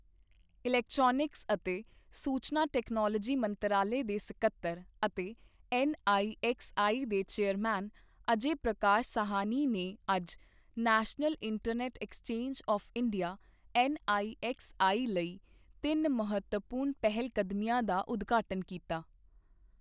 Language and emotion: Punjabi, neutral